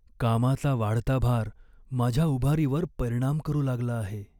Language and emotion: Marathi, sad